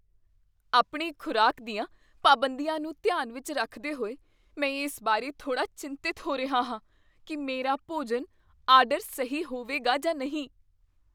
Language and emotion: Punjabi, fearful